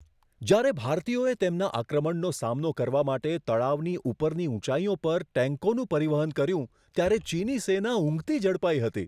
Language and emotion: Gujarati, surprised